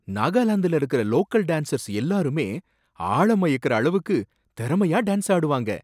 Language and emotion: Tamil, surprised